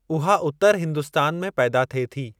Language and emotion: Sindhi, neutral